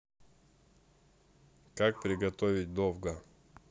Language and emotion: Russian, neutral